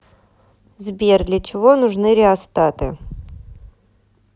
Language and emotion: Russian, neutral